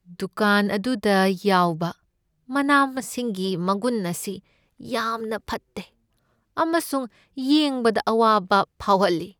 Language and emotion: Manipuri, sad